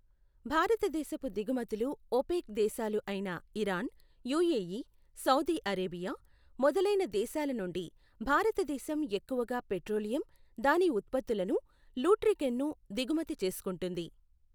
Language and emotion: Telugu, neutral